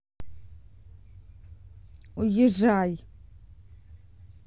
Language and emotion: Russian, angry